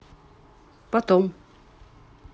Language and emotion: Russian, neutral